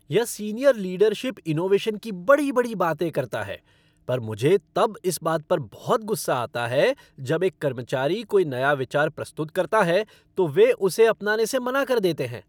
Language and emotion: Hindi, angry